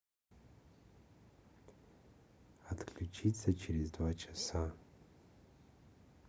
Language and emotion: Russian, neutral